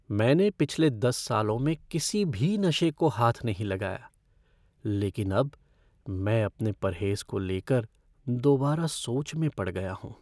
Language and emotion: Hindi, fearful